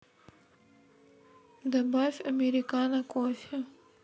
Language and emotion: Russian, sad